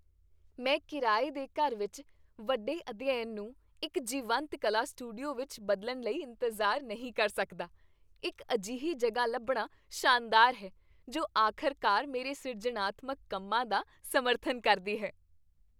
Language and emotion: Punjabi, happy